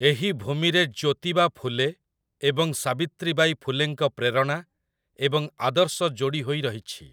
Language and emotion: Odia, neutral